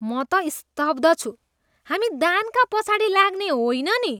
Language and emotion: Nepali, disgusted